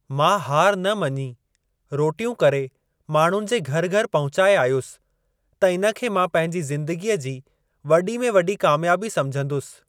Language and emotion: Sindhi, neutral